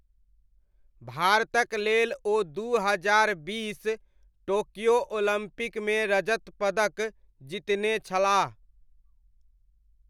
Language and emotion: Maithili, neutral